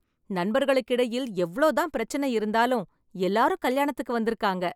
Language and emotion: Tamil, happy